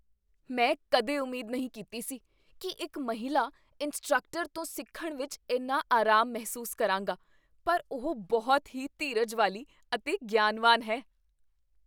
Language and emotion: Punjabi, surprised